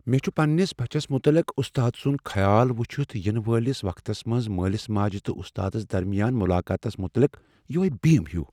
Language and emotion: Kashmiri, fearful